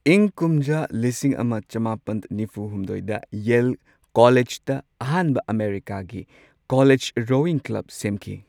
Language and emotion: Manipuri, neutral